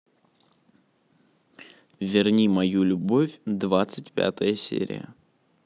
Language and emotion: Russian, neutral